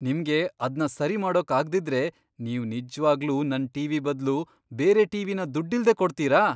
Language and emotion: Kannada, surprised